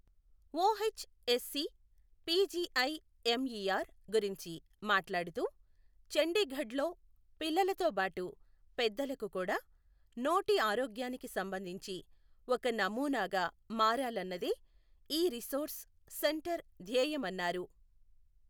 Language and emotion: Telugu, neutral